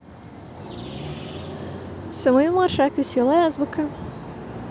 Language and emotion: Russian, positive